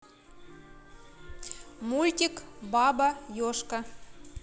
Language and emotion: Russian, neutral